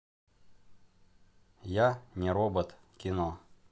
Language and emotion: Russian, neutral